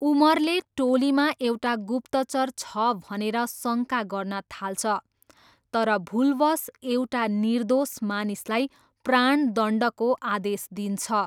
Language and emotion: Nepali, neutral